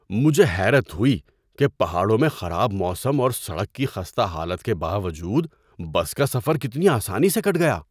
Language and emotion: Urdu, surprised